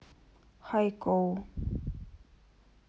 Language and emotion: Russian, neutral